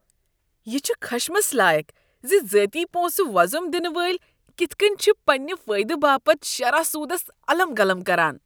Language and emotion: Kashmiri, disgusted